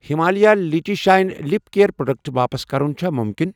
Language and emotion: Kashmiri, neutral